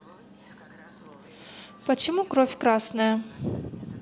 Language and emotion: Russian, neutral